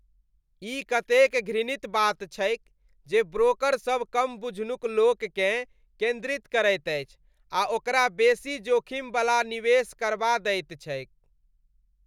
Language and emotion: Maithili, disgusted